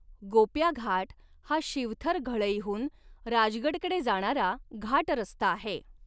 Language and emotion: Marathi, neutral